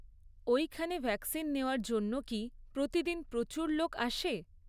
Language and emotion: Bengali, neutral